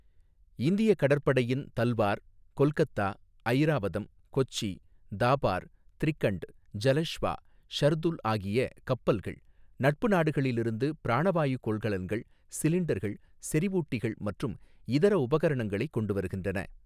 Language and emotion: Tamil, neutral